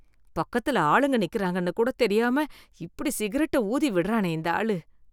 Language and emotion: Tamil, disgusted